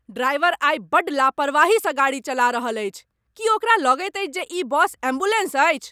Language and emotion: Maithili, angry